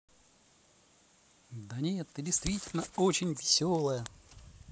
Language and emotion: Russian, positive